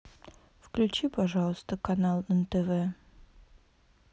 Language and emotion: Russian, sad